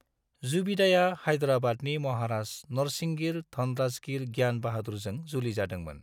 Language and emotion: Bodo, neutral